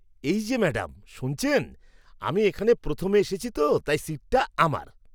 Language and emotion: Bengali, angry